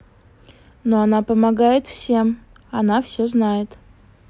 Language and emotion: Russian, positive